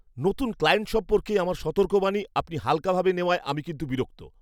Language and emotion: Bengali, angry